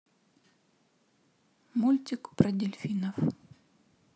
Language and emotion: Russian, sad